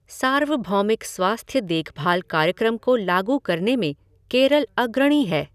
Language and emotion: Hindi, neutral